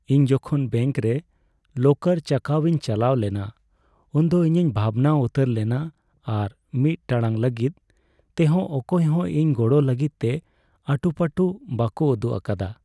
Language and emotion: Santali, sad